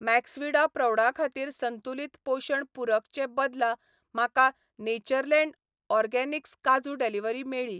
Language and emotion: Goan Konkani, neutral